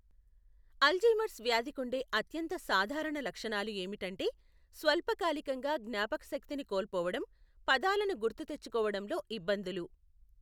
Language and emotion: Telugu, neutral